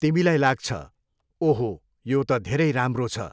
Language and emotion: Nepali, neutral